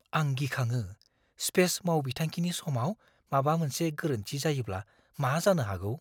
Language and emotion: Bodo, fearful